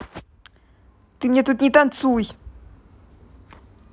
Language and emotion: Russian, angry